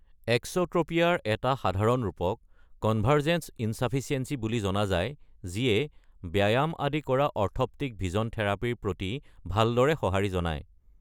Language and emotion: Assamese, neutral